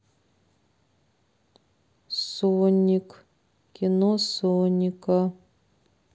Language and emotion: Russian, neutral